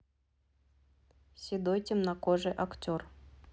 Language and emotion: Russian, neutral